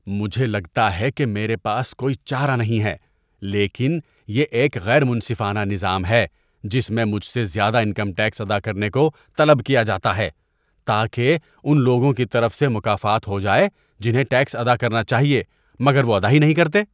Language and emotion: Urdu, disgusted